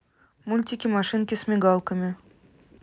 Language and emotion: Russian, neutral